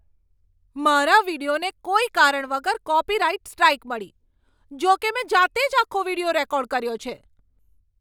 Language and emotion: Gujarati, angry